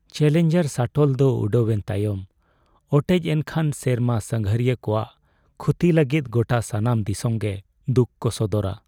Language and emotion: Santali, sad